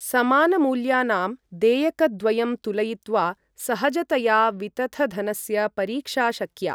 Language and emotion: Sanskrit, neutral